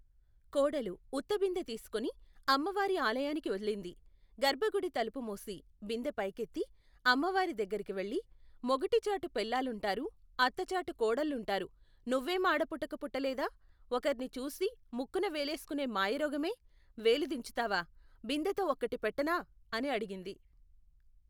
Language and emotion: Telugu, neutral